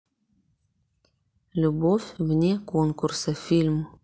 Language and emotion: Russian, neutral